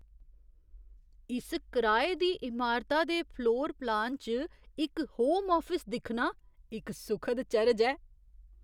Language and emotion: Dogri, surprised